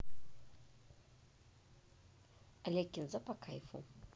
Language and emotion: Russian, neutral